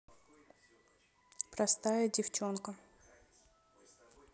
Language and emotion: Russian, neutral